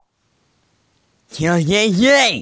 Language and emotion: Russian, positive